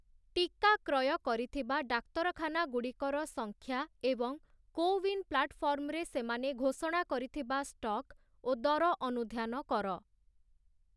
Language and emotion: Odia, neutral